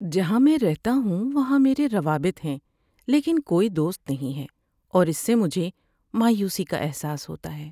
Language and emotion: Urdu, sad